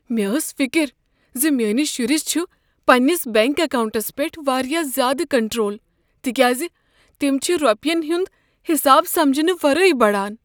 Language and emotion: Kashmiri, fearful